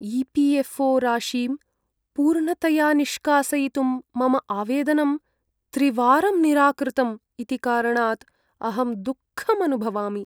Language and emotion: Sanskrit, sad